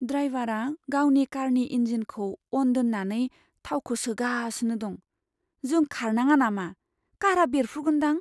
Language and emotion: Bodo, fearful